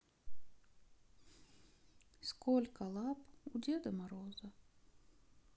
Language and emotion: Russian, sad